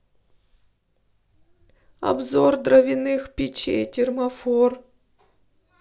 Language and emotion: Russian, sad